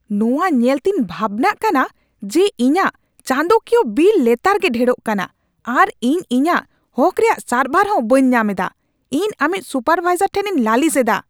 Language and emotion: Santali, angry